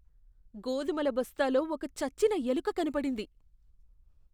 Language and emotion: Telugu, disgusted